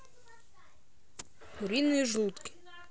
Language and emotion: Russian, neutral